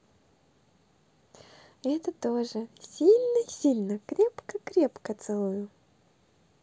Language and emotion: Russian, positive